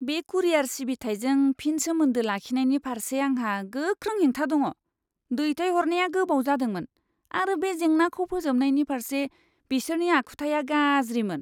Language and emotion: Bodo, disgusted